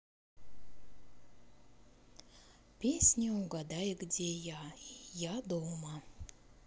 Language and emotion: Russian, positive